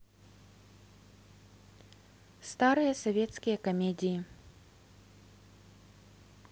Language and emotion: Russian, neutral